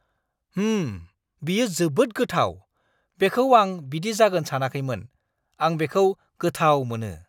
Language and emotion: Bodo, surprised